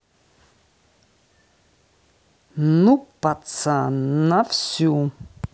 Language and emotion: Russian, neutral